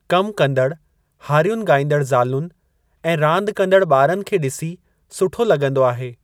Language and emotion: Sindhi, neutral